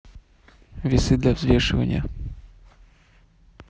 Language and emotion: Russian, neutral